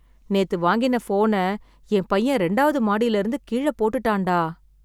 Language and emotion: Tamil, sad